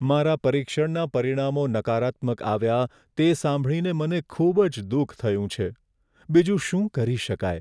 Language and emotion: Gujarati, sad